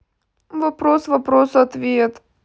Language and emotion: Russian, sad